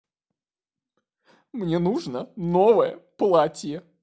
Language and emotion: Russian, sad